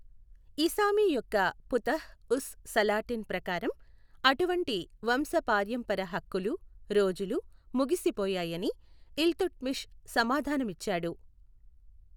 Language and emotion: Telugu, neutral